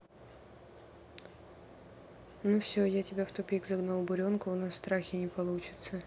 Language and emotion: Russian, neutral